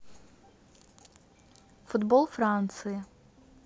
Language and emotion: Russian, neutral